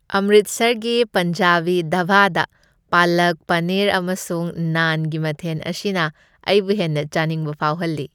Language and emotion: Manipuri, happy